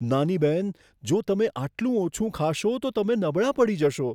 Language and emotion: Gujarati, fearful